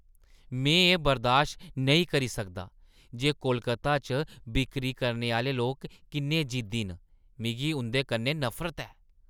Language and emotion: Dogri, disgusted